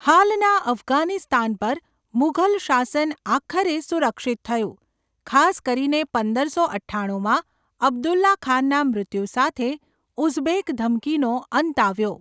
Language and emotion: Gujarati, neutral